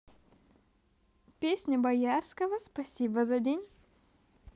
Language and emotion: Russian, positive